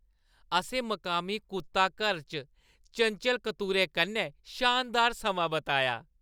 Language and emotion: Dogri, happy